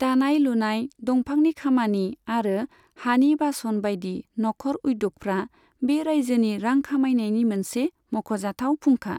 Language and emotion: Bodo, neutral